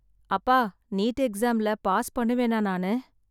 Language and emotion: Tamil, sad